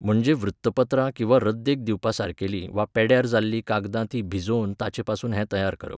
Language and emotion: Goan Konkani, neutral